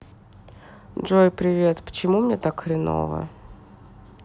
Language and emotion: Russian, sad